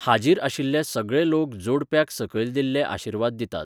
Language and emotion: Goan Konkani, neutral